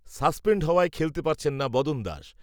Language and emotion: Bengali, neutral